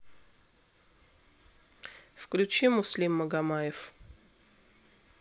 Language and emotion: Russian, neutral